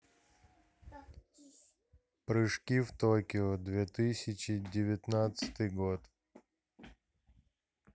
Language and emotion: Russian, neutral